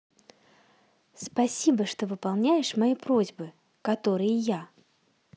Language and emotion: Russian, positive